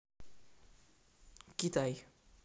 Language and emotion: Russian, neutral